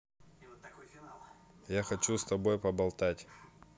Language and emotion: Russian, neutral